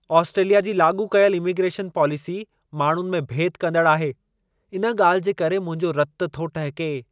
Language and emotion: Sindhi, angry